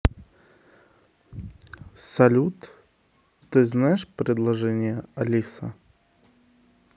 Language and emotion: Russian, neutral